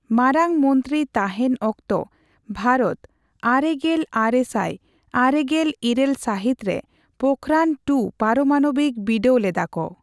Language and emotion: Santali, neutral